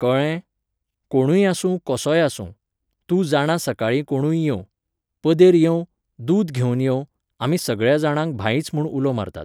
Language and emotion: Goan Konkani, neutral